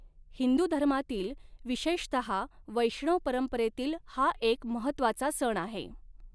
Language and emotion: Marathi, neutral